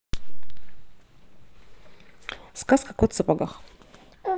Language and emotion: Russian, neutral